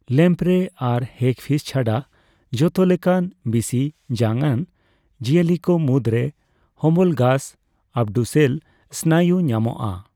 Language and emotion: Santali, neutral